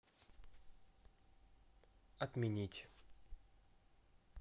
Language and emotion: Russian, neutral